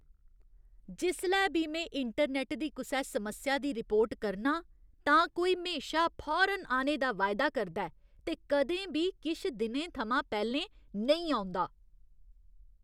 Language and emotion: Dogri, disgusted